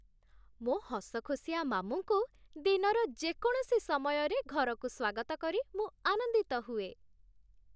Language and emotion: Odia, happy